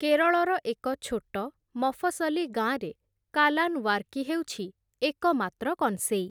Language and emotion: Odia, neutral